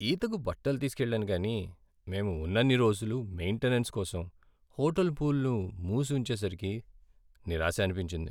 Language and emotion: Telugu, sad